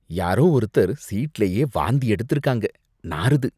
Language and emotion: Tamil, disgusted